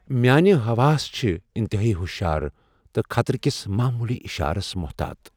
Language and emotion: Kashmiri, fearful